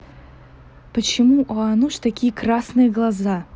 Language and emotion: Russian, neutral